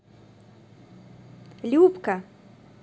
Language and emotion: Russian, positive